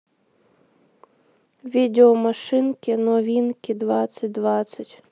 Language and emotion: Russian, sad